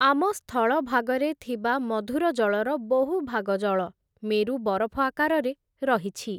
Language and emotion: Odia, neutral